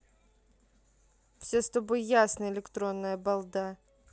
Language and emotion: Russian, neutral